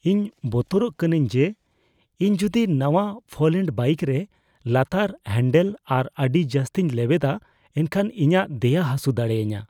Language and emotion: Santali, fearful